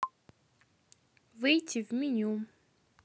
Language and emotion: Russian, neutral